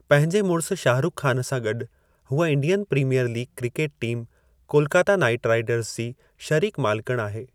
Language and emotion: Sindhi, neutral